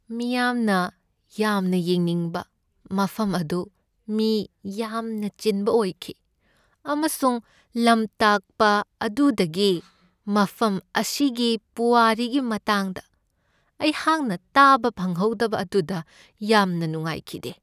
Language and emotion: Manipuri, sad